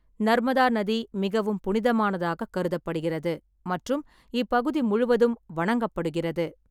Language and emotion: Tamil, neutral